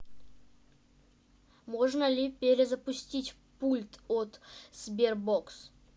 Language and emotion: Russian, neutral